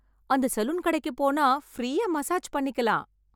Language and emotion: Tamil, happy